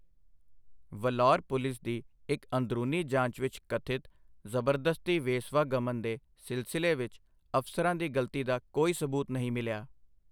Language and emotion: Punjabi, neutral